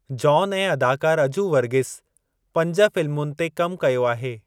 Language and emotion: Sindhi, neutral